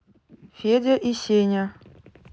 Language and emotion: Russian, neutral